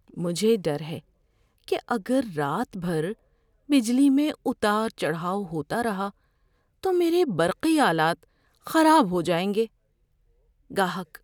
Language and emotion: Urdu, fearful